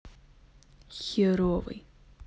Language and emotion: Russian, sad